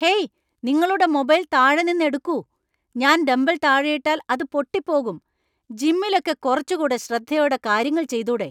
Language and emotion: Malayalam, angry